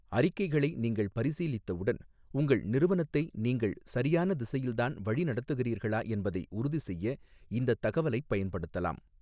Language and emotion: Tamil, neutral